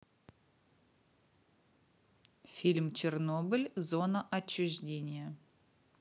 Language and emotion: Russian, neutral